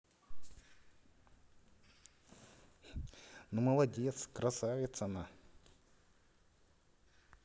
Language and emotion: Russian, positive